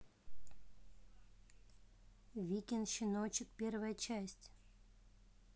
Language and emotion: Russian, neutral